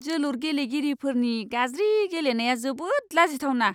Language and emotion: Bodo, disgusted